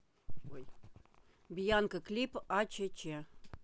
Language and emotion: Russian, neutral